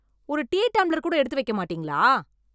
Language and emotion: Tamil, angry